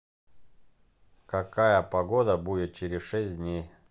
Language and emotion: Russian, neutral